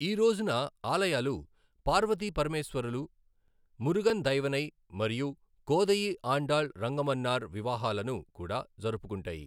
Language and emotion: Telugu, neutral